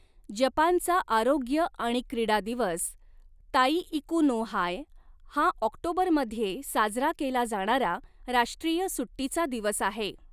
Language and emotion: Marathi, neutral